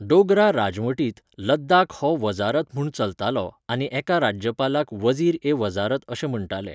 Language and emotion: Goan Konkani, neutral